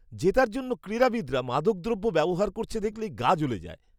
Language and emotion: Bengali, disgusted